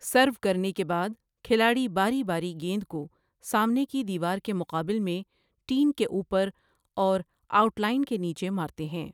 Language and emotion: Urdu, neutral